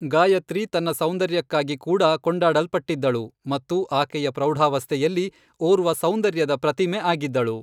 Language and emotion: Kannada, neutral